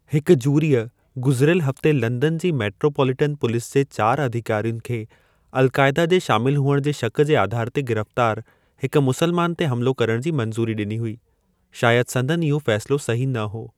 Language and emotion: Sindhi, neutral